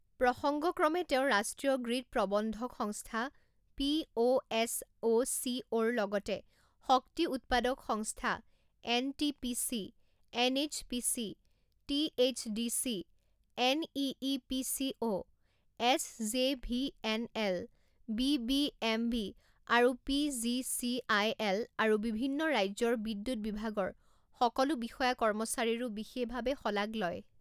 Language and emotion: Assamese, neutral